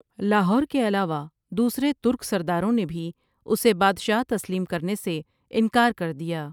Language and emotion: Urdu, neutral